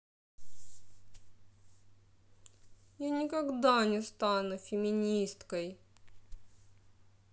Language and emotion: Russian, sad